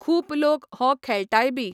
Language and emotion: Goan Konkani, neutral